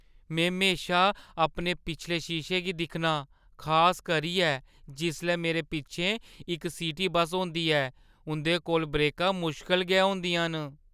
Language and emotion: Dogri, fearful